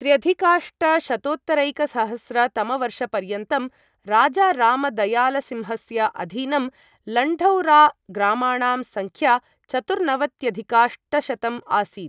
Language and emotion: Sanskrit, neutral